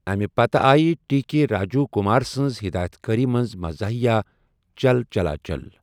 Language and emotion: Kashmiri, neutral